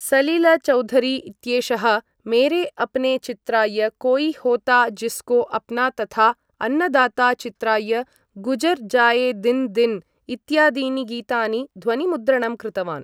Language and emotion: Sanskrit, neutral